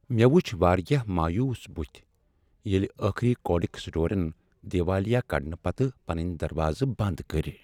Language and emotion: Kashmiri, sad